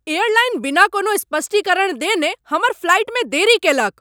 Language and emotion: Maithili, angry